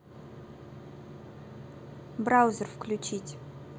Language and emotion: Russian, neutral